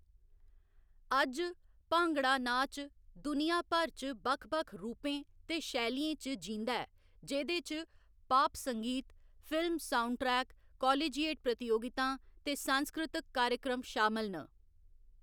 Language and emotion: Dogri, neutral